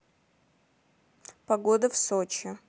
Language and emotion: Russian, neutral